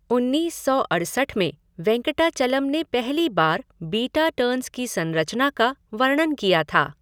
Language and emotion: Hindi, neutral